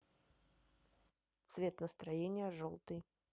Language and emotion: Russian, neutral